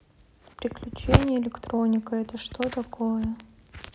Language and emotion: Russian, neutral